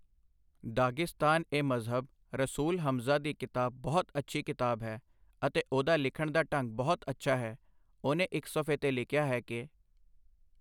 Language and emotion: Punjabi, neutral